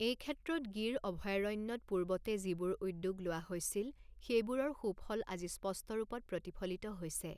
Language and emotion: Assamese, neutral